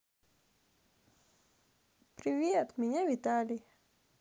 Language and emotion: Russian, positive